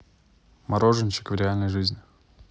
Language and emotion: Russian, neutral